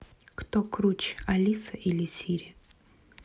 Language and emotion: Russian, neutral